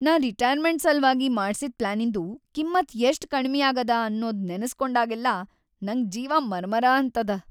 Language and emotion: Kannada, sad